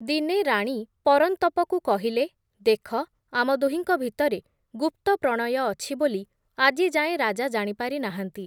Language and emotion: Odia, neutral